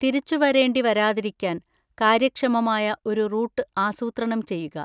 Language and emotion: Malayalam, neutral